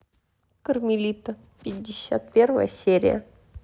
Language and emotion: Russian, neutral